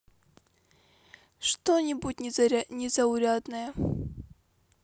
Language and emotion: Russian, neutral